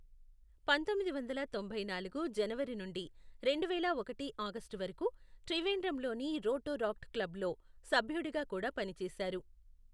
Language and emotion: Telugu, neutral